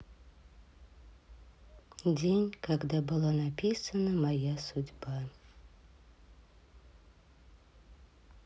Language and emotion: Russian, sad